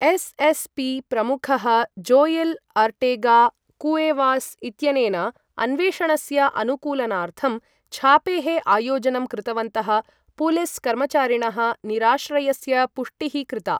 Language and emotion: Sanskrit, neutral